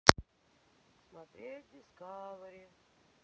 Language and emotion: Russian, sad